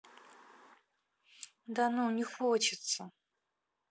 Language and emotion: Russian, neutral